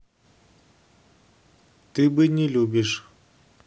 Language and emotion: Russian, neutral